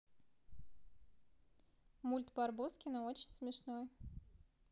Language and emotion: Russian, neutral